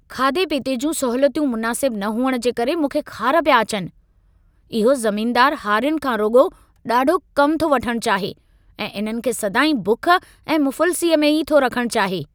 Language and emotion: Sindhi, angry